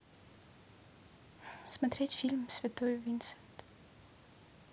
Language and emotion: Russian, neutral